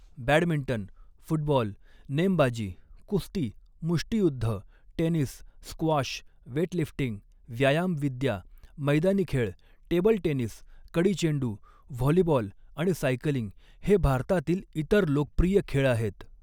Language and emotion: Marathi, neutral